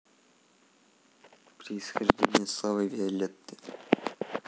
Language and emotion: Russian, neutral